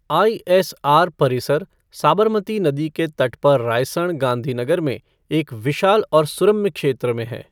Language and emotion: Hindi, neutral